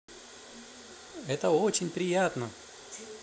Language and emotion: Russian, positive